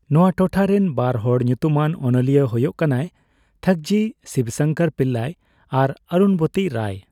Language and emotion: Santali, neutral